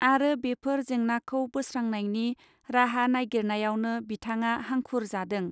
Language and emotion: Bodo, neutral